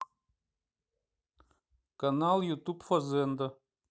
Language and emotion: Russian, neutral